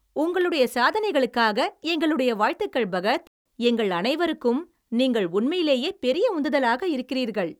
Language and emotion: Tamil, happy